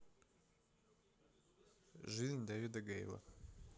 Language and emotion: Russian, neutral